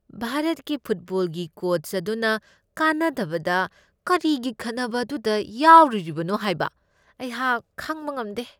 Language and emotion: Manipuri, disgusted